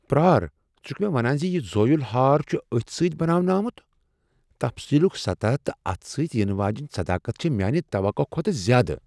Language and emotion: Kashmiri, surprised